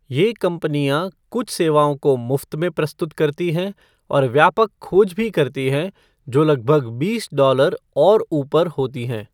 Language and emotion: Hindi, neutral